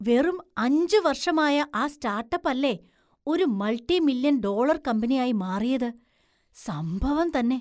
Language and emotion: Malayalam, surprised